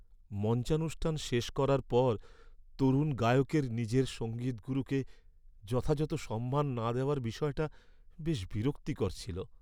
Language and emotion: Bengali, sad